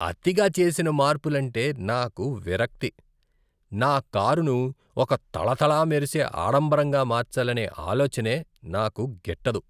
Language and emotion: Telugu, disgusted